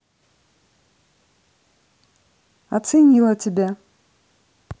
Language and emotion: Russian, neutral